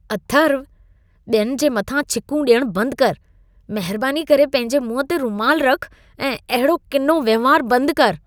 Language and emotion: Sindhi, disgusted